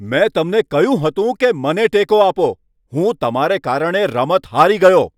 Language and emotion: Gujarati, angry